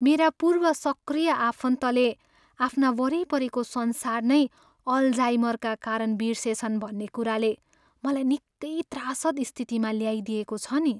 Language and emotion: Nepali, sad